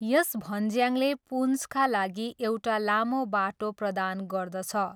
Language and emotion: Nepali, neutral